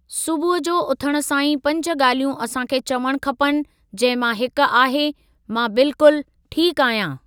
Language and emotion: Sindhi, neutral